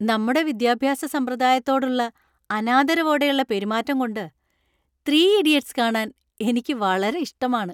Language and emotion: Malayalam, happy